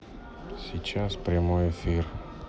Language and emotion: Russian, sad